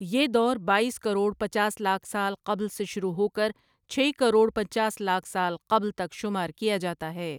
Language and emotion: Urdu, neutral